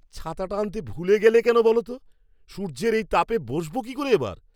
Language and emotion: Bengali, angry